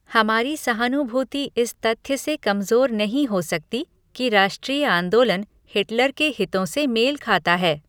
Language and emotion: Hindi, neutral